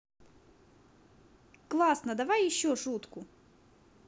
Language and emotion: Russian, positive